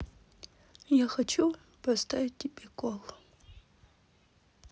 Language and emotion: Russian, sad